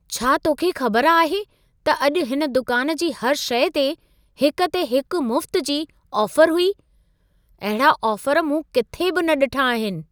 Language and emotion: Sindhi, surprised